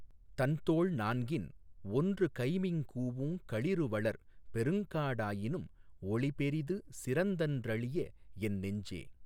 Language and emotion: Tamil, neutral